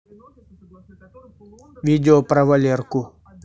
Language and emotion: Russian, neutral